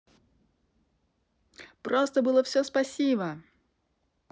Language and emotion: Russian, positive